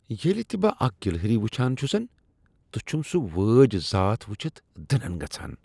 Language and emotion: Kashmiri, disgusted